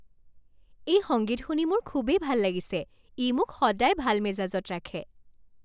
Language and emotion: Assamese, happy